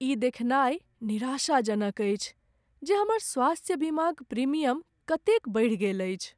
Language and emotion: Maithili, sad